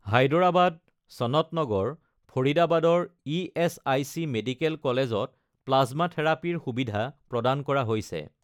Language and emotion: Assamese, neutral